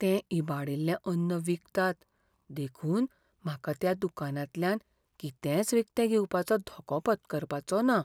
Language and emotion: Goan Konkani, fearful